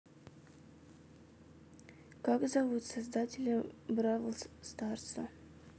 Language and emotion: Russian, neutral